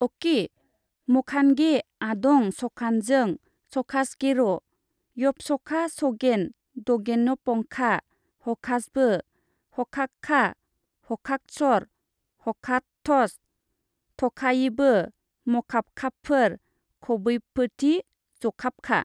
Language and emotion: Bodo, neutral